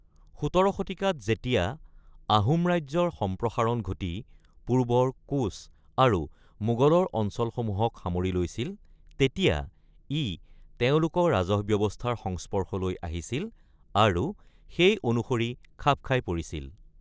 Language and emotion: Assamese, neutral